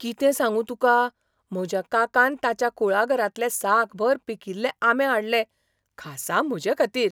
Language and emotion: Goan Konkani, surprised